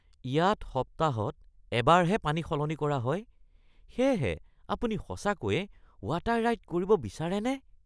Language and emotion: Assamese, disgusted